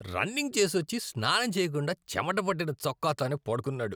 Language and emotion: Telugu, disgusted